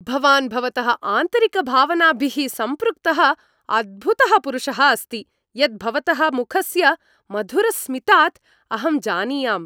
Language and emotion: Sanskrit, happy